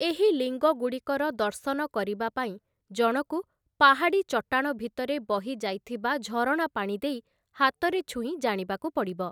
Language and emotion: Odia, neutral